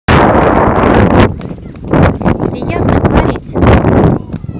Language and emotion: Russian, positive